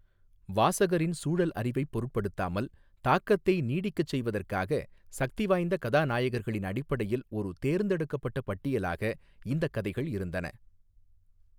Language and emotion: Tamil, neutral